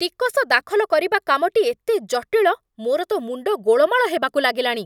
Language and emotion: Odia, angry